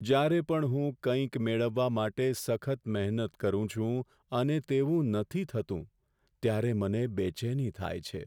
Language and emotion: Gujarati, sad